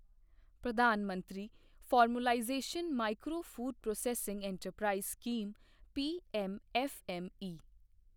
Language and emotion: Punjabi, neutral